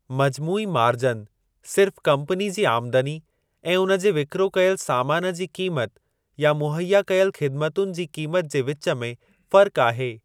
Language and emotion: Sindhi, neutral